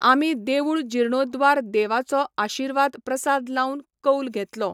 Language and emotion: Goan Konkani, neutral